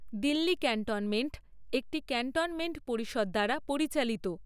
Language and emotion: Bengali, neutral